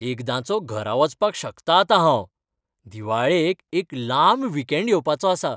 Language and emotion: Goan Konkani, happy